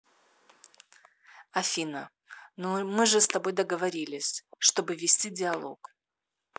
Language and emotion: Russian, neutral